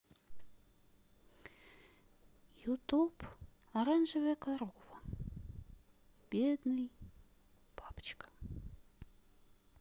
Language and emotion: Russian, sad